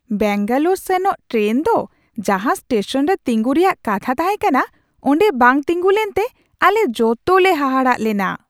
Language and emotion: Santali, surprised